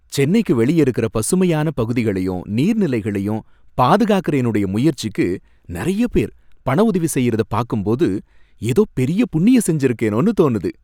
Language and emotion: Tamil, happy